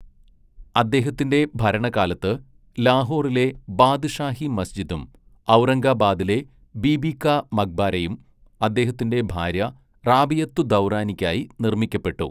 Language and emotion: Malayalam, neutral